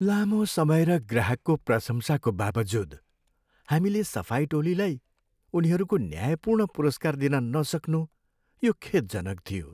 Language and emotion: Nepali, sad